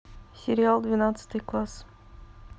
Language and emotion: Russian, neutral